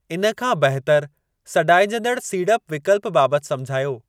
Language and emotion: Sindhi, neutral